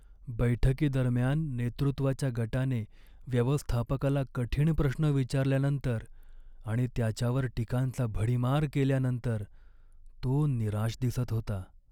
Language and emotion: Marathi, sad